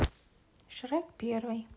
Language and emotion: Russian, neutral